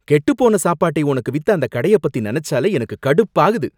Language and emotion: Tamil, angry